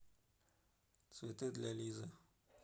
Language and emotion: Russian, neutral